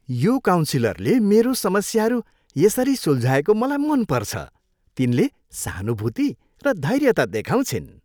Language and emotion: Nepali, happy